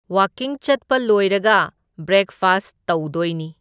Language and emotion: Manipuri, neutral